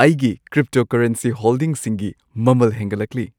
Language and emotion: Manipuri, happy